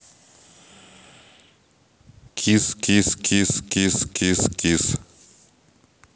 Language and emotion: Russian, neutral